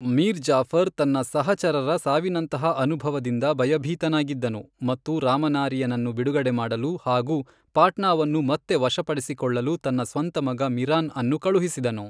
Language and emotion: Kannada, neutral